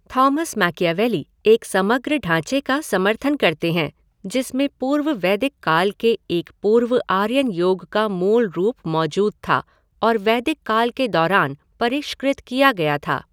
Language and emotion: Hindi, neutral